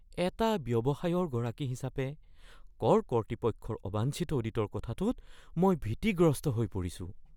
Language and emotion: Assamese, fearful